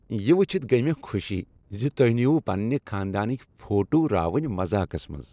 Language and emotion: Kashmiri, happy